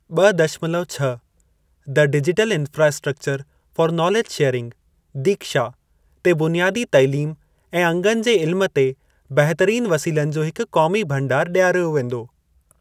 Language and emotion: Sindhi, neutral